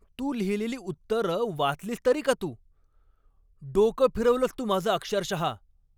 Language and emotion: Marathi, angry